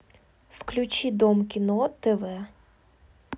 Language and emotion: Russian, neutral